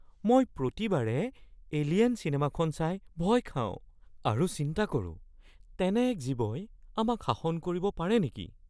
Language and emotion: Assamese, fearful